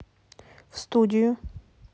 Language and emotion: Russian, neutral